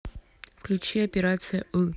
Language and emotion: Russian, neutral